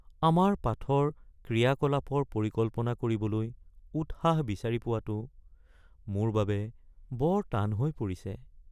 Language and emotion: Assamese, sad